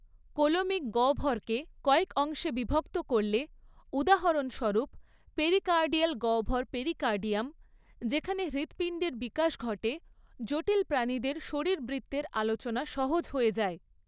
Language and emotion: Bengali, neutral